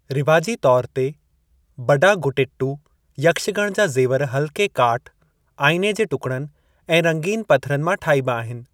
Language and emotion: Sindhi, neutral